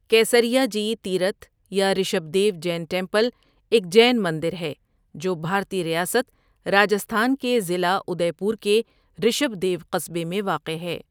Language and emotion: Urdu, neutral